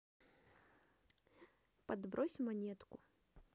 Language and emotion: Russian, neutral